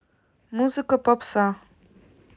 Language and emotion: Russian, neutral